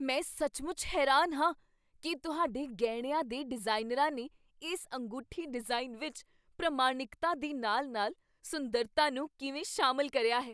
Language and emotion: Punjabi, surprised